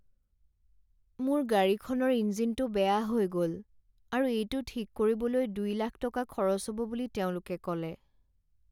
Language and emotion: Assamese, sad